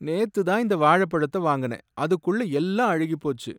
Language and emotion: Tamil, sad